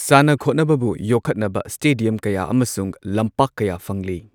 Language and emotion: Manipuri, neutral